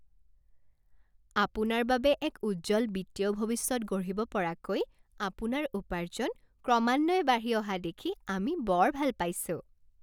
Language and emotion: Assamese, happy